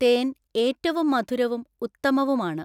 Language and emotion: Malayalam, neutral